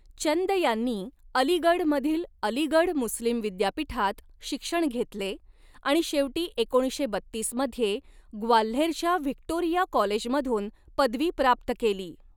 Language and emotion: Marathi, neutral